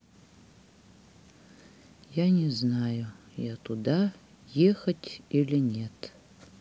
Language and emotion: Russian, sad